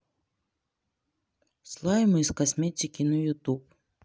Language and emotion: Russian, neutral